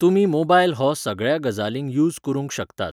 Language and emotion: Goan Konkani, neutral